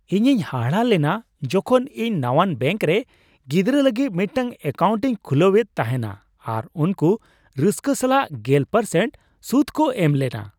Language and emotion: Santali, surprised